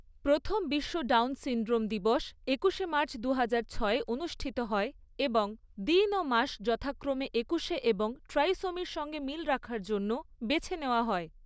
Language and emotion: Bengali, neutral